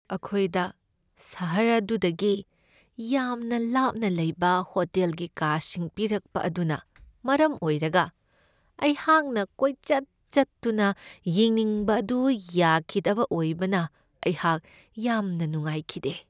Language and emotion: Manipuri, sad